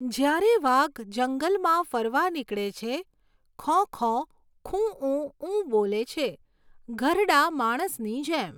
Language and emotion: Gujarati, neutral